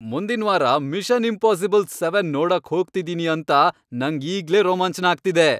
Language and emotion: Kannada, happy